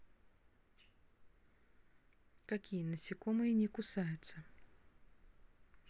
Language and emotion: Russian, neutral